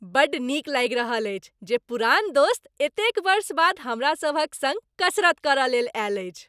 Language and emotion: Maithili, happy